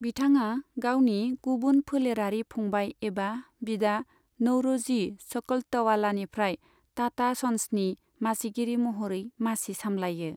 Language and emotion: Bodo, neutral